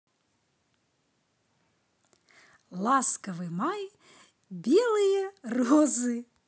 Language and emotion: Russian, positive